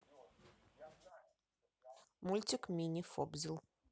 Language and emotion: Russian, neutral